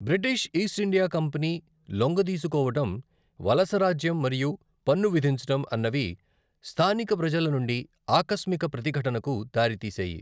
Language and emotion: Telugu, neutral